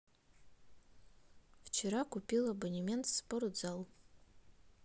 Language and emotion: Russian, neutral